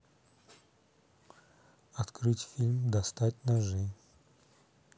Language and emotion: Russian, neutral